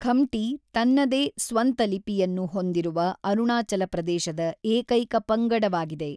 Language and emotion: Kannada, neutral